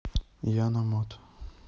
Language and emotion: Russian, neutral